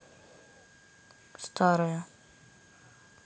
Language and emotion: Russian, neutral